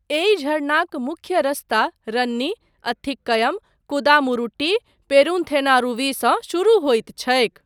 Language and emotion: Maithili, neutral